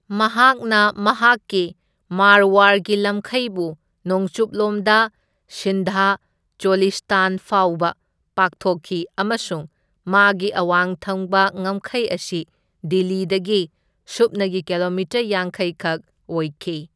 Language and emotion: Manipuri, neutral